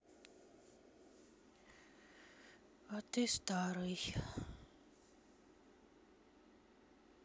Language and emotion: Russian, sad